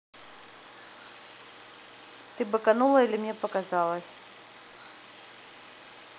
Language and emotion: Russian, neutral